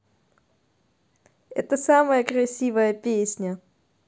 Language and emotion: Russian, positive